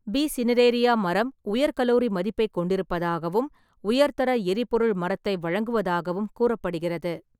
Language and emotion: Tamil, neutral